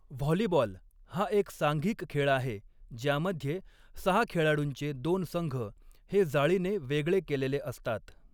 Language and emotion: Marathi, neutral